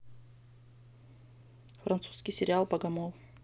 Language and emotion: Russian, neutral